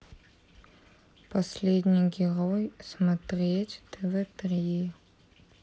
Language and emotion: Russian, neutral